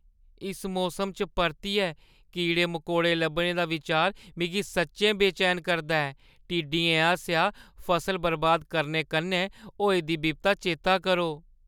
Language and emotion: Dogri, fearful